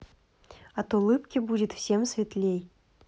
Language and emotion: Russian, positive